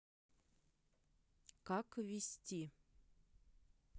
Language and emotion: Russian, neutral